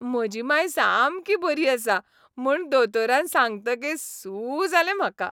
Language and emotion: Goan Konkani, happy